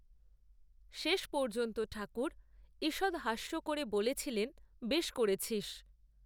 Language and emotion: Bengali, neutral